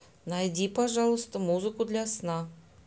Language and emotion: Russian, neutral